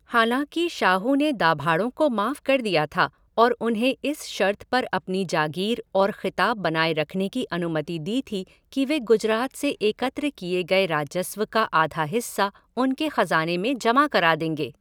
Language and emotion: Hindi, neutral